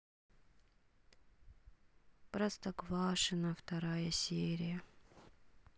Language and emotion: Russian, sad